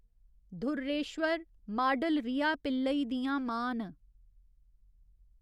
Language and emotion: Dogri, neutral